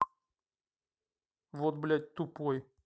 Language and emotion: Russian, angry